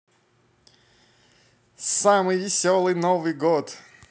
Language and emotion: Russian, positive